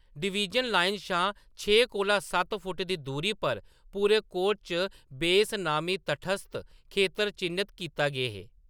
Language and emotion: Dogri, neutral